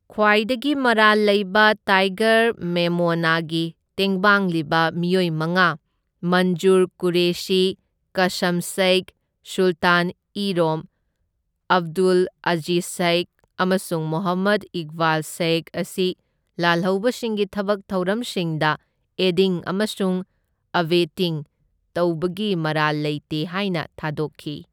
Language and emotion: Manipuri, neutral